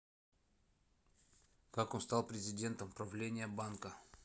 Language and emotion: Russian, neutral